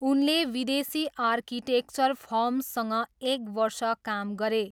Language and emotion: Nepali, neutral